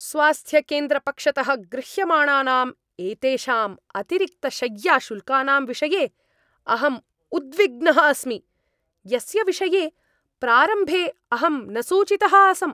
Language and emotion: Sanskrit, angry